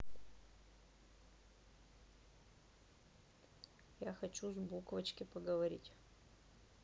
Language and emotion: Russian, neutral